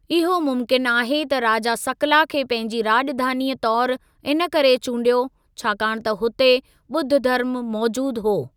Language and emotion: Sindhi, neutral